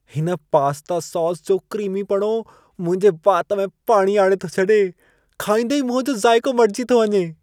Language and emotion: Sindhi, happy